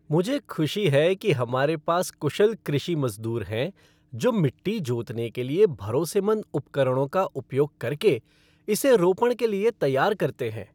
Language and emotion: Hindi, happy